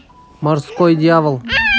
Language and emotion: Russian, neutral